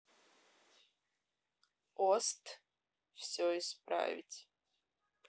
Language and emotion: Russian, neutral